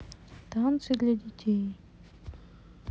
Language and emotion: Russian, sad